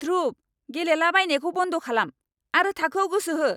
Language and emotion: Bodo, angry